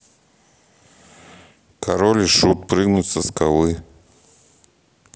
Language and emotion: Russian, neutral